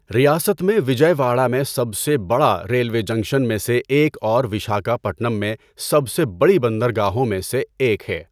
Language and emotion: Urdu, neutral